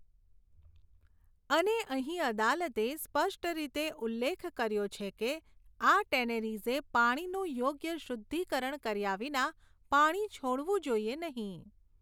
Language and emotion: Gujarati, neutral